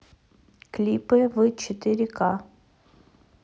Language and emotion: Russian, neutral